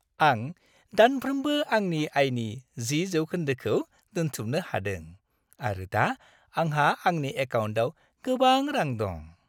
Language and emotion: Bodo, happy